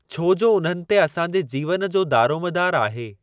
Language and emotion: Sindhi, neutral